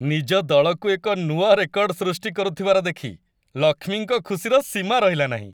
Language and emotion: Odia, happy